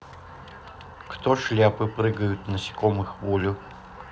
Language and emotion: Russian, neutral